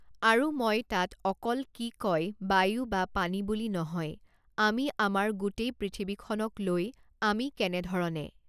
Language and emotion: Assamese, neutral